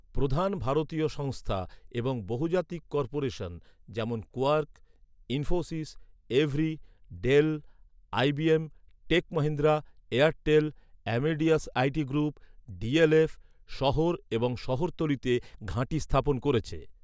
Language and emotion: Bengali, neutral